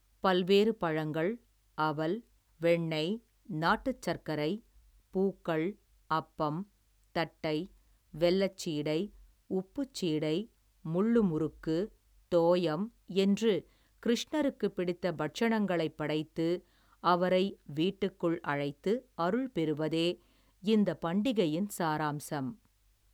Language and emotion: Tamil, neutral